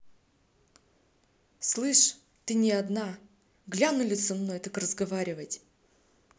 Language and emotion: Russian, angry